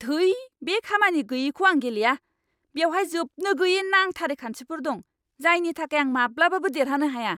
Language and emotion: Bodo, angry